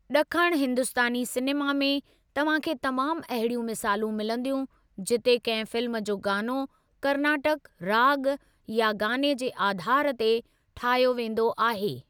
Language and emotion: Sindhi, neutral